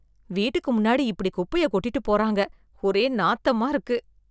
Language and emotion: Tamil, disgusted